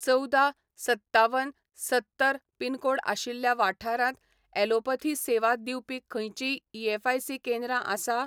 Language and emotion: Goan Konkani, neutral